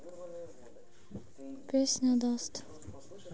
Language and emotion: Russian, sad